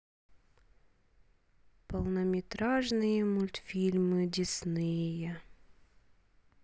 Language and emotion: Russian, sad